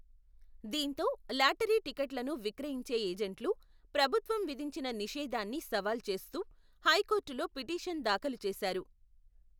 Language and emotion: Telugu, neutral